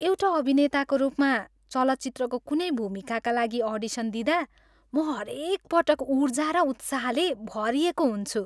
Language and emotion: Nepali, happy